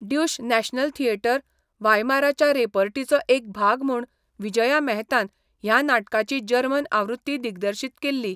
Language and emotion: Goan Konkani, neutral